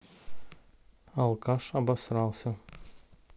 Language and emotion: Russian, neutral